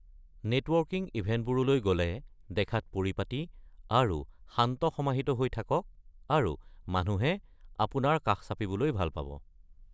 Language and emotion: Assamese, neutral